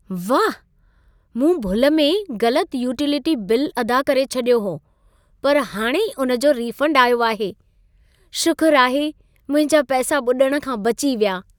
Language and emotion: Sindhi, happy